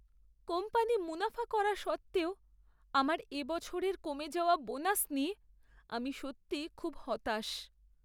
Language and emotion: Bengali, sad